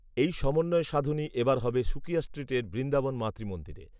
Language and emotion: Bengali, neutral